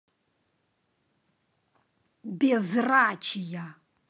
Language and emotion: Russian, angry